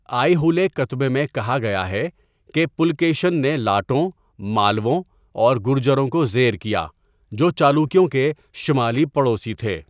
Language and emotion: Urdu, neutral